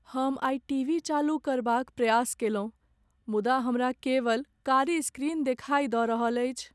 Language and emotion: Maithili, sad